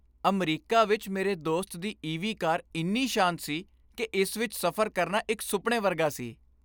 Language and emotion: Punjabi, happy